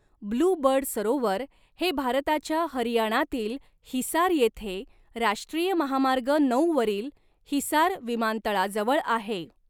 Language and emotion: Marathi, neutral